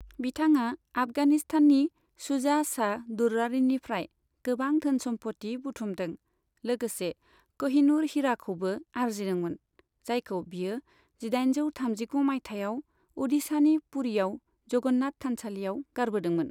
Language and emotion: Bodo, neutral